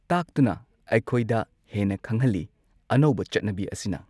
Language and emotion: Manipuri, neutral